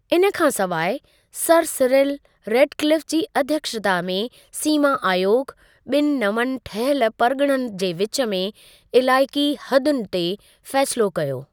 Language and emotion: Sindhi, neutral